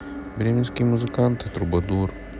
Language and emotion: Russian, sad